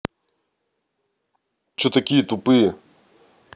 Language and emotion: Russian, angry